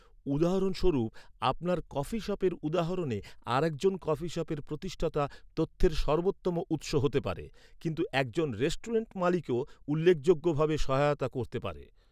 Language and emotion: Bengali, neutral